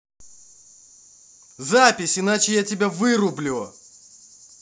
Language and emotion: Russian, angry